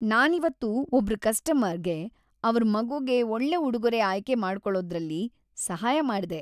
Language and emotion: Kannada, happy